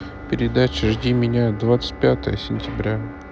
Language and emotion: Russian, neutral